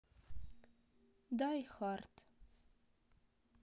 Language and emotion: Russian, neutral